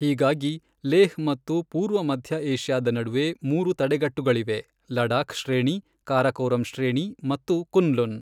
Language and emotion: Kannada, neutral